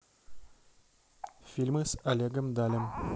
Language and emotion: Russian, neutral